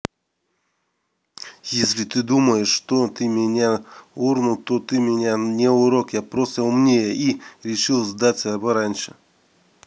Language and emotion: Russian, neutral